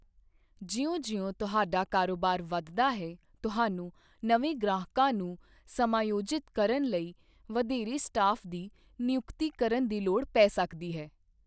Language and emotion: Punjabi, neutral